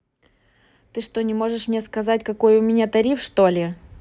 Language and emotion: Russian, angry